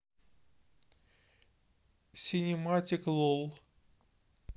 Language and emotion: Russian, neutral